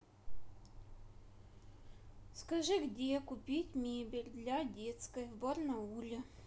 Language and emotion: Russian, neutral